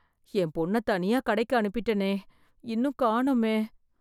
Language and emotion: Tamil, fearful